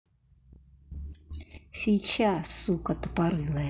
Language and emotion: Russian, angry